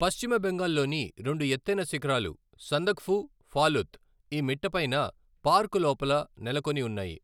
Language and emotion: Telugu, neutral